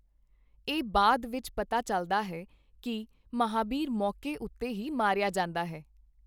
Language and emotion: Punjabi, neutral